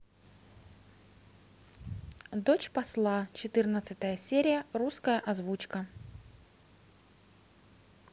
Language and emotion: Russian, neutral